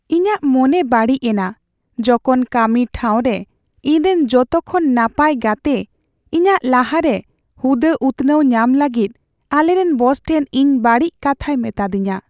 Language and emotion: Santali, sad